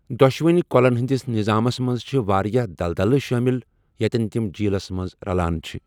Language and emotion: Kashmiri, neutral